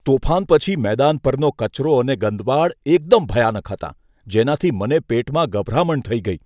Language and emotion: Gujarati, disgusted